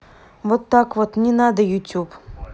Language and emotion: Russian, neutral